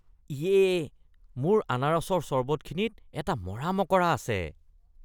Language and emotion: Assamese, disgusted